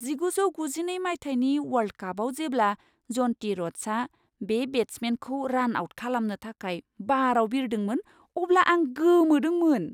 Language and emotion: Bodo, surprised